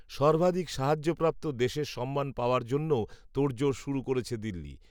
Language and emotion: Bengali, neutral